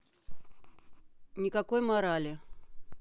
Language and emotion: Russian, neutral